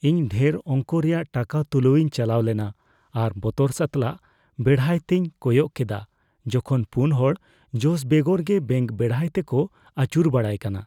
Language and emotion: Santali, fearful